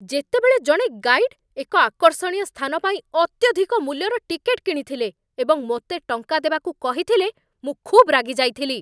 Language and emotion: Odia, angry